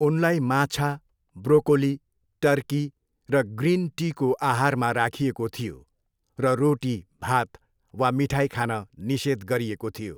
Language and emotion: Nepali, neutral